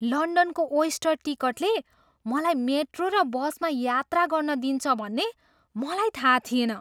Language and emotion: Nepali, surprised